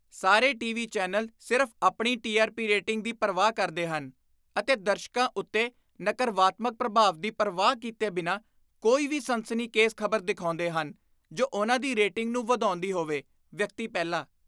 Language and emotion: Punjabi, disgusted